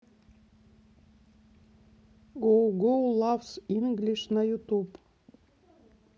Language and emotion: Russian, neutral